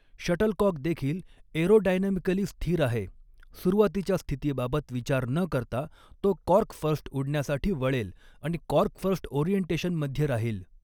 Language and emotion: Marathi, neutral